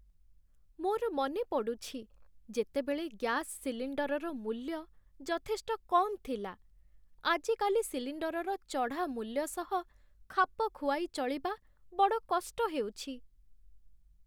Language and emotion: Odia, sad